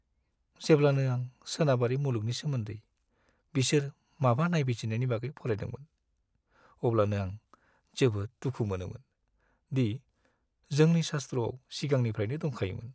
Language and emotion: Bodo, sad